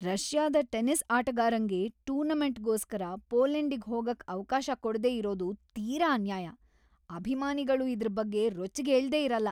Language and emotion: Kannada, angry